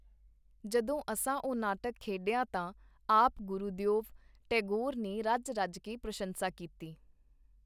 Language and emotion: Punjabi, neutral